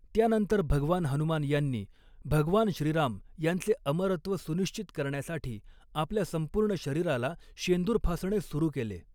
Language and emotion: Marathi, neutral